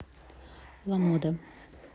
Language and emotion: Russian, neutral